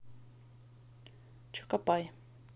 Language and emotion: Russian, neutral